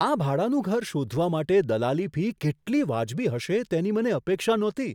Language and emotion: Gujarati, surprised